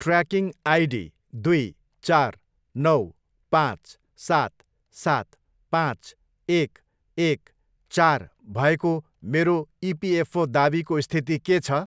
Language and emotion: Nepali, neutral